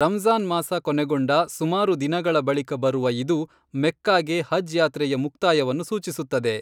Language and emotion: Kannada, neutral